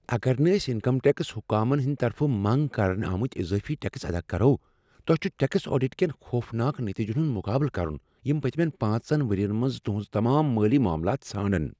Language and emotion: Kashmiri, fearful